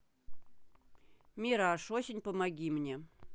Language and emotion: Russian, neutral